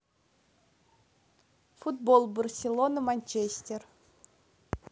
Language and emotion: Russian, neutral